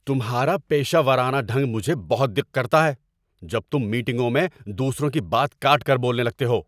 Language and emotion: Urdu, angry